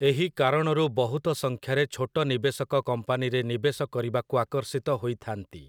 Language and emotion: Odia, neutral